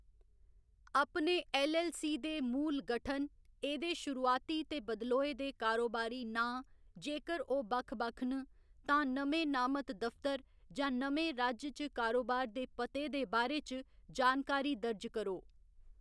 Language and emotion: Dogri, neutral